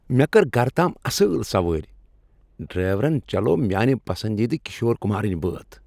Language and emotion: Kashmiri, happy